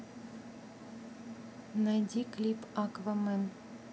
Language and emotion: Russian, neutral